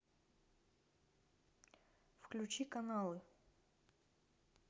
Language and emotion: Russian, neutral